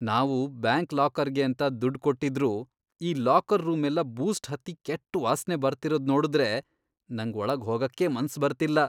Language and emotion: Kannada, disgusted